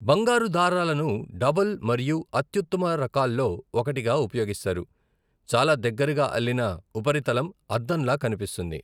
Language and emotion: Telugu, neutral